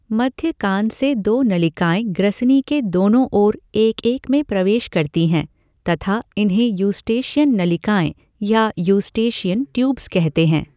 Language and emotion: Hindi, neutral